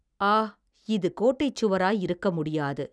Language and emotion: Tamil, neutral